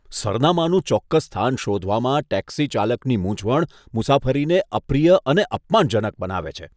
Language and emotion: Gujarati, disgusted